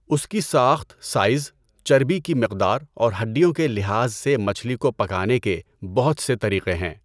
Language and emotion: Urdu, neutral